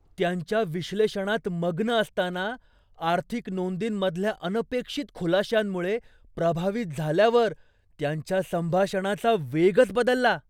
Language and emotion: Marathi, surprised